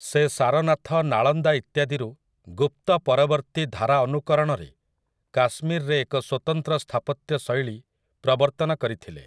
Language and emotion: Odia, neutral